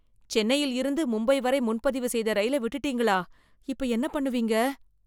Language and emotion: Tamil, fearful